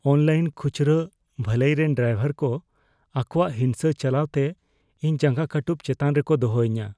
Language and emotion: Santali, fearful